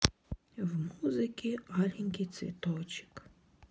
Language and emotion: Russian, sad